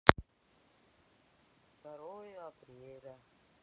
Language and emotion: Russian, sad